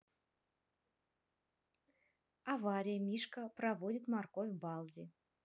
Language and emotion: Russian, neutral